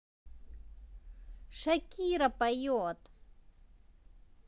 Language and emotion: Russian, positive